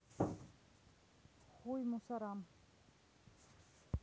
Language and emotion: Russian, neutral